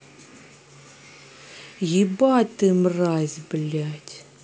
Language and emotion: Russian, angry